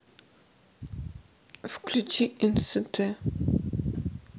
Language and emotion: Russian, sad